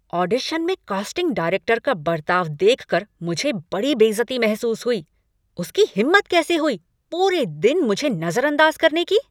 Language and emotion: Hindi, angry